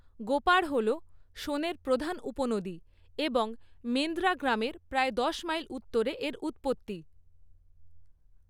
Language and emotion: Bengali, neutral